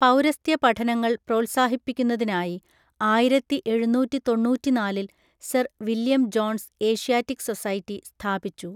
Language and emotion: Malayalam, neutral